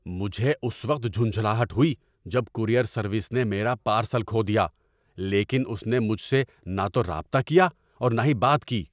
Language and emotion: Urdu, angry